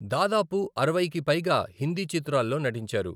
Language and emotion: Telugu, neutral